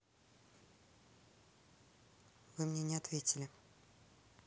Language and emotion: Russian, neutral